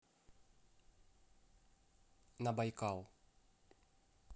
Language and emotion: Russian, neutral